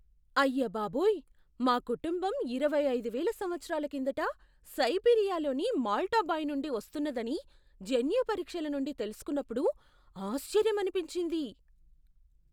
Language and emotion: Telugu, surprised